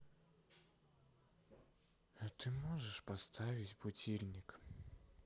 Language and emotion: Russian, sad